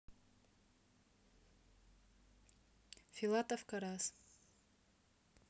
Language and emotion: Russian, neutral